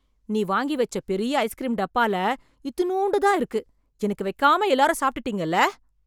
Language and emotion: Tamil, angry